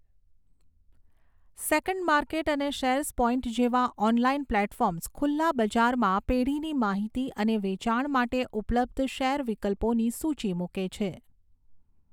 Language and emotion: Gujarati, neutral